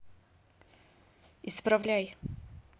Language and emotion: Russian, angry